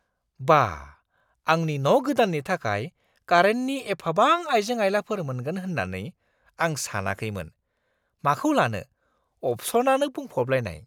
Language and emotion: Bodo, surprised